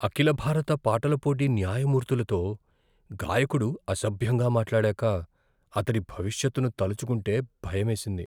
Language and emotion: Telugu, fearful